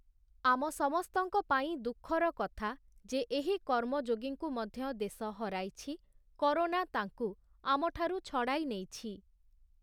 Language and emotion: Odia, neutral